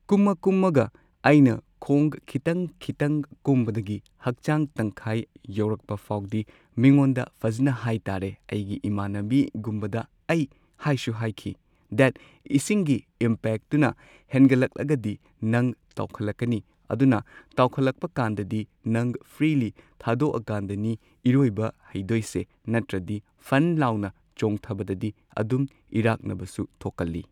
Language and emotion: Manipuri, neutral